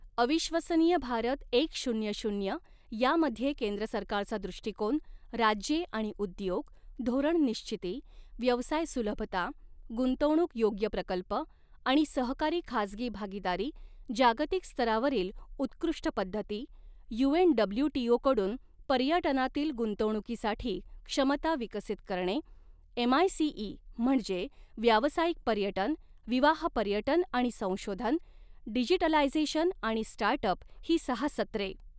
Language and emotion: Marathi, neutral